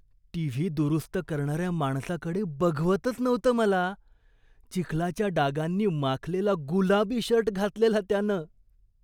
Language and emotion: Marathi, disgusted